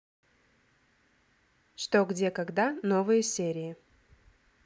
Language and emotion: Russian, neutral